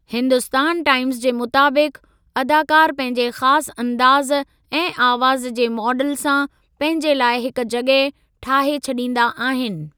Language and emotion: Sindhi, neutral